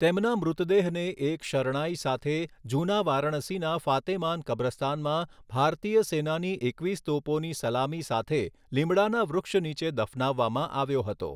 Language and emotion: Gujarati, neutral